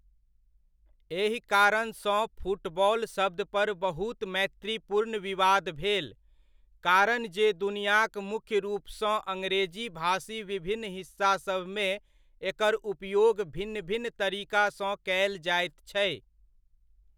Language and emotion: Maithili, neutral